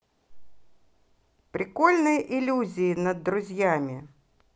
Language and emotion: Russian, positive